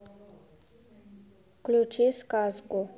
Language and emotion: Russian, neutral